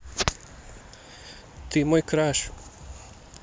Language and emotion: Russian, neutral